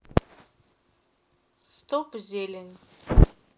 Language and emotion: Russian, sad